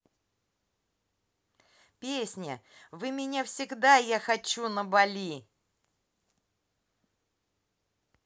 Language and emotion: Russian, positive